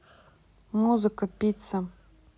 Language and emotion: Russian, neutral